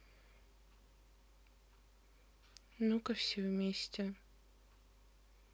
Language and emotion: Russian, sad